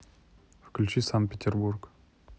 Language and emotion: Russian, neutral